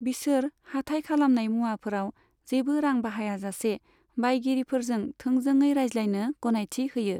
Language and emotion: Bodo, neutral